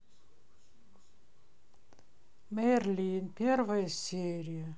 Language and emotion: Russian, sad